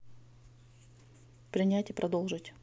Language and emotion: Russian, neutral